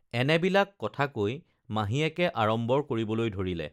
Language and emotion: Assamese, neutral